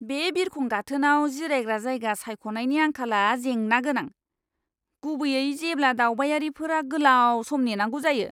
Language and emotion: Bodo, disgusted